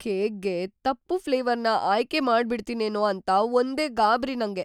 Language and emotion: Kannada, fearful